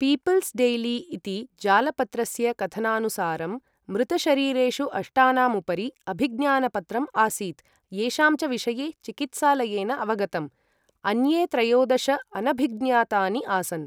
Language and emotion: Sanskrit, neutral